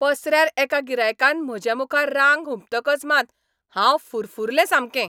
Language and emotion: Goan Konkani, angry